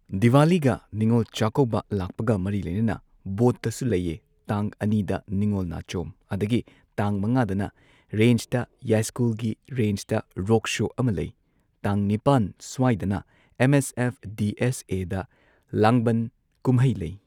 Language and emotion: Manipuri, neutral